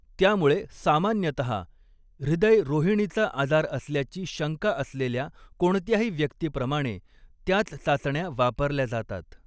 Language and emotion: Marathi, neutral